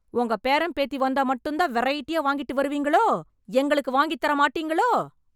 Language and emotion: Tamil, angry